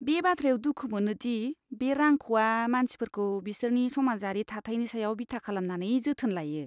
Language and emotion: Bodo, disgusted